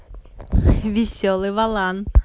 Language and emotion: Russian, positive